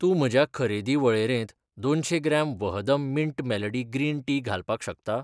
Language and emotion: Goan Konkani, neutral